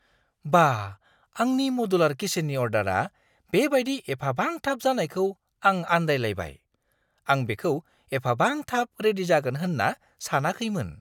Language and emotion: Bodo, surprised